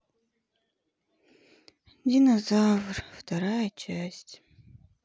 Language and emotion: Russian, sad